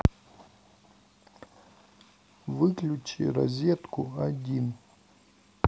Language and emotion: Russian, neutral